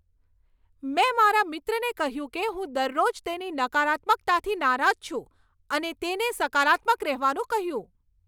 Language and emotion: Gujarati, angry